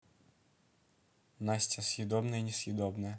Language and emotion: Russian, neutral